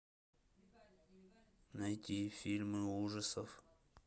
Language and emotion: Russian, neutral